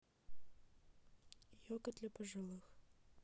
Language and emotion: Russian, neutral